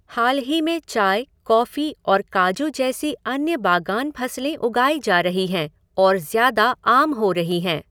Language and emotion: Hindi, neutral